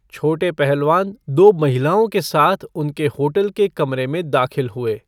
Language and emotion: Hindi, neutral